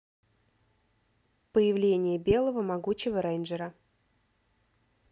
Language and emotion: Russian, neutral